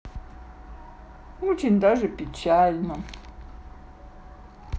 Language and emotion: Russian, sad